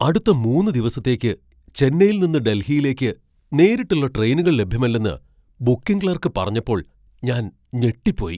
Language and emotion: Malayalam, surprised